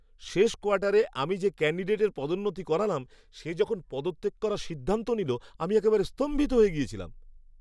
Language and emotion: Bengali, surprised